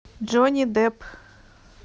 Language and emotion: Russian, neutral